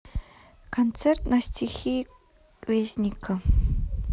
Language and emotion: Russian, neutral